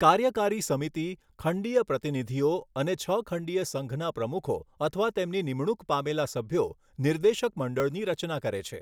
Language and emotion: Gujarati, neutral